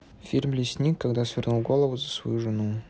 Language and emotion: Russian, neutral